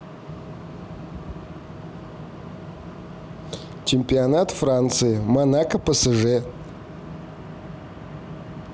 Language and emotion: Russian, neutral